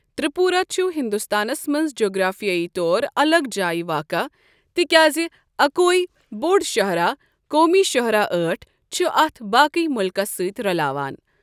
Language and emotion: Kashmiri, neutral